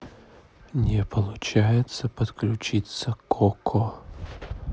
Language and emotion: Russian, neutral